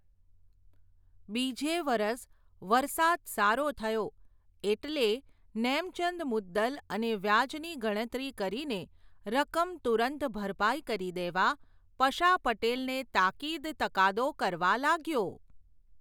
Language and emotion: Gujarati, neutral